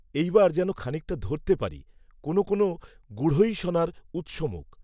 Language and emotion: Bengali, neutral